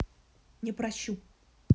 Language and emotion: Russian, angry